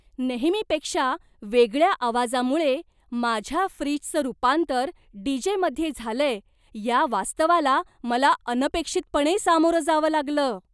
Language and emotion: Marathi, surprised